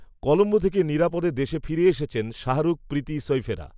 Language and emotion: Bengali, neutral